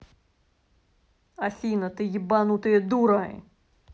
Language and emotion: Russian, angry